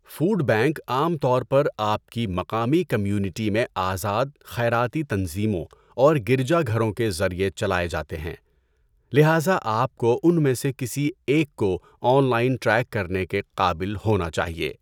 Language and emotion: Urdu, neutral